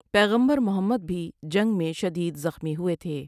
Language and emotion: Urdu, neutral